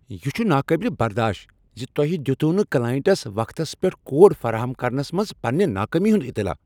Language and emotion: Kashmiri, angry